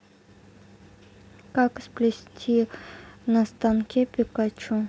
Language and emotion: Russian, neutral